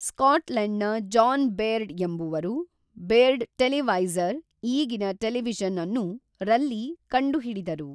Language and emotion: Kannada, neutral